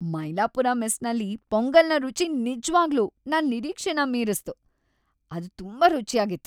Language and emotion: Kannada, happy